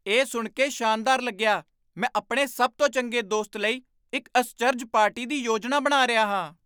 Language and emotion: Punjabi, surprised